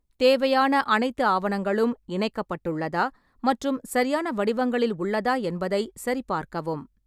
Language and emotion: Tamil, neutral